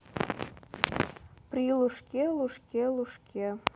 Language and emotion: Russian, neutral